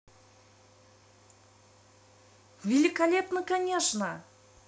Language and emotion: Russian, positive